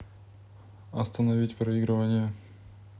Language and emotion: Russian, neutral